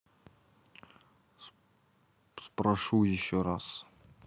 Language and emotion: Russian, neutral